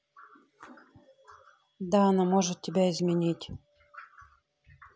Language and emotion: Russian, neutral